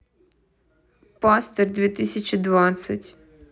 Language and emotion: Russian, neutral